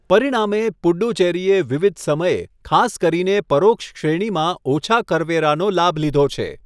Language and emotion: Gujarati, neutral